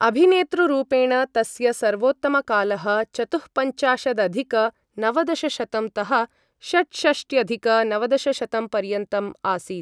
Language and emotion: Sanskrit, neutral